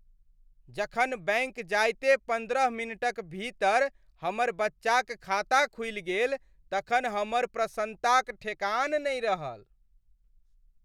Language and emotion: Maithili, happy